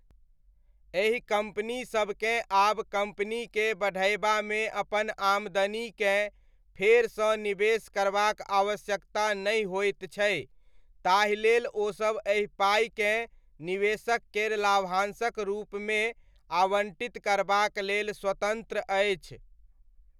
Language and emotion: Maithili, neutral